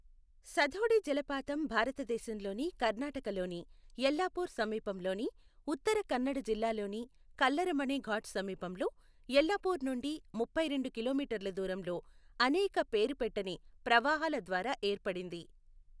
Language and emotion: Telugu, neutral